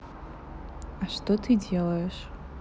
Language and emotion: Russian, neutral